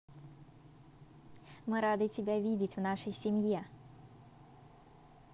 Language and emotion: Russian, positive